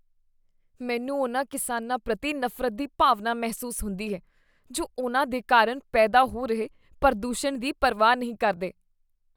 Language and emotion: Punjabi, disgusted